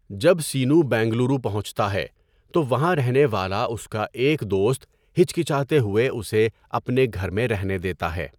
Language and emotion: Urdu, neutral